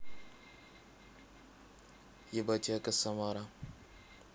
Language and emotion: Russian, neutral